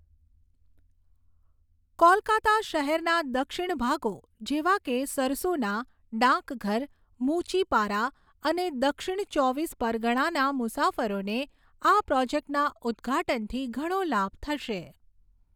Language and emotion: Gujarati, neutral